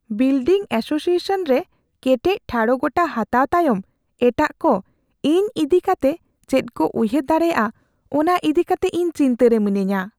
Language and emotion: Santali, fearful